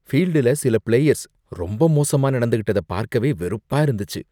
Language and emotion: Tamil, disgusted